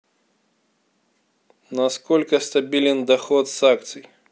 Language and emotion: Russian, neutral